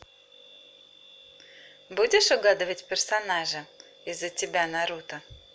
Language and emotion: Russian, positive